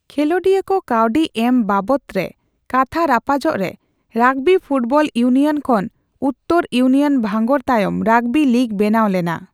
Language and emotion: Santali, neutral